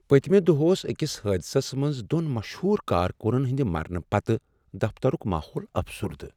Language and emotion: Kashmiri, sad